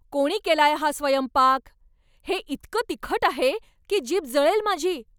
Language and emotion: Marathi, angry